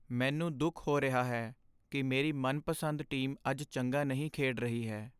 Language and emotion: Punjabi, sad